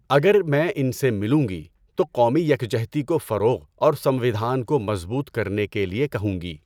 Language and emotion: Urdu, neutral